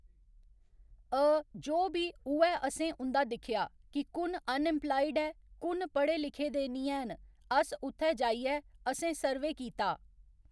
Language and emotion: Dogri, neutral